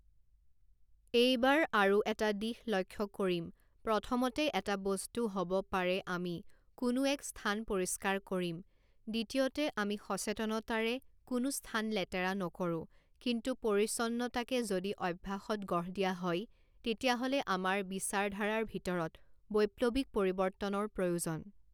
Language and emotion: Assamese, neutral